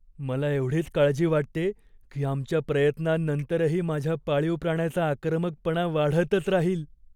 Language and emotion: Marathi, fearful